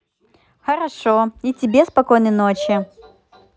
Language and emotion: Russian, positive